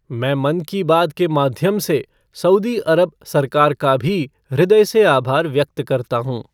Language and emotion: Hindi, neutral